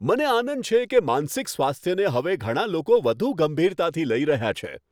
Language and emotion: Gujarati, happy